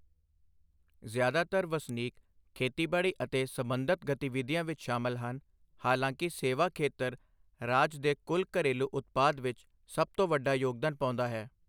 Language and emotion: Punjabi, neutral